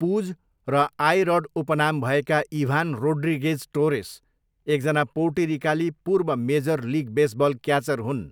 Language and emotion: Nepali, neutral